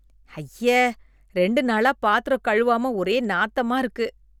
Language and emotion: Tamil, disgusted